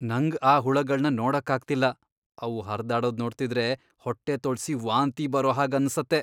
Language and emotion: Kannada, disgusted